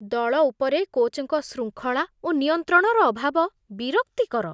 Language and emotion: Odia, disgusted